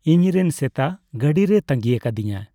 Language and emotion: Santali, neutral